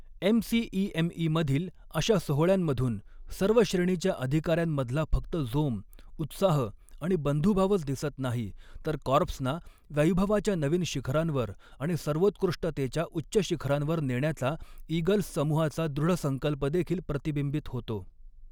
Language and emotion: Marathi, neutral